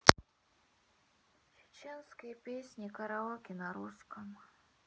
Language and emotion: Russian, sad